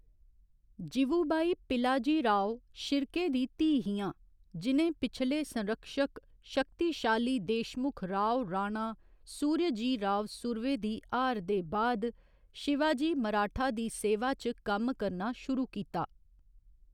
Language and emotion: Dogri, neutral